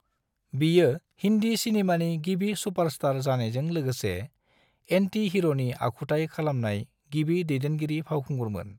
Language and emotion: Bodo, neutral